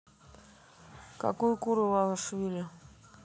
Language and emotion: Russian, neutral